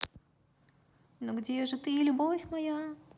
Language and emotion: Russian, positive